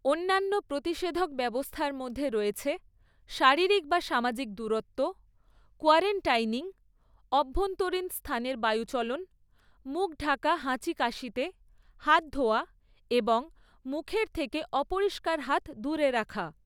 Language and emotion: Bengali, neutral